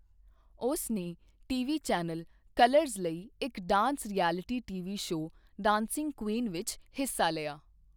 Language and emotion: Punjabi, neutral